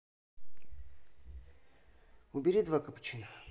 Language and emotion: Russian, neutral